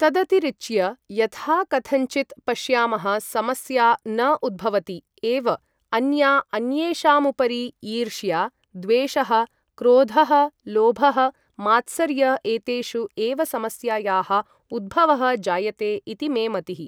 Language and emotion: Sanskrit, neutral